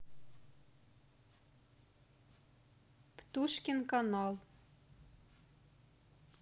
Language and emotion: Russian, neutral